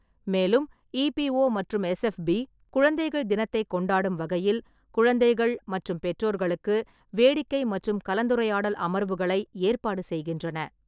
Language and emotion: Tamil, neutral